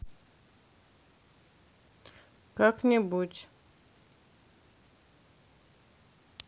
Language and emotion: Russian, neutral